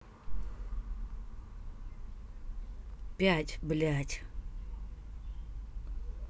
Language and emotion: Russian, angry